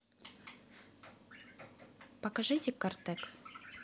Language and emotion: Russian, neutral